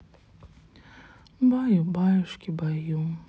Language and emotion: Russian, sad